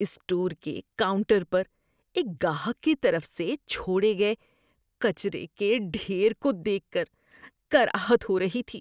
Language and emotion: Urdu, disgusted